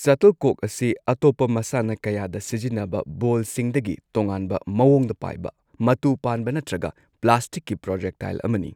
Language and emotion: Manipuri, neutral